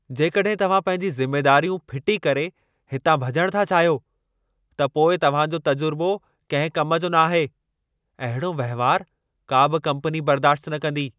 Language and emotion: Sindhi, angry